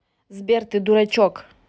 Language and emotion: Russian, neutral